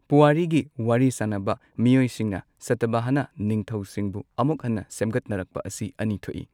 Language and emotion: Manipuri, neutral